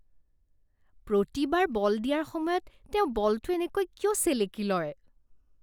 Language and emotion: Assamese, disgusted